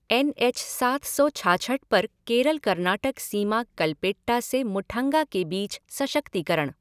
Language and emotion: Hindi, neutral